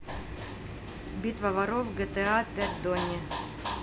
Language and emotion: Russian, neutral